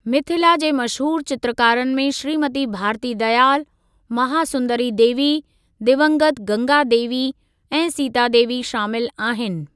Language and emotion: Sindhi, neutral